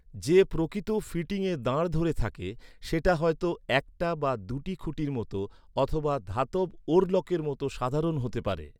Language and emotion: Bengali, neutral